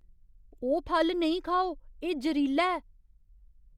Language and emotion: Dogri, fearful